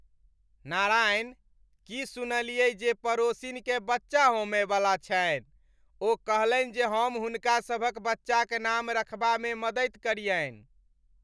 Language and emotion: Maithili, happy